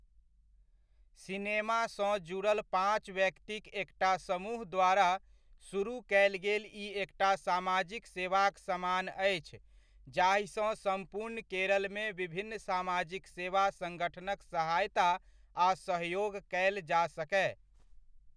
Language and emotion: Maithili, neutral